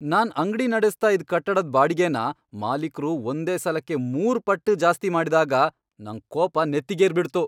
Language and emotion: Kannada, angry